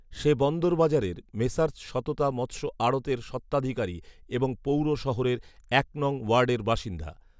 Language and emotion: Bengali, neutral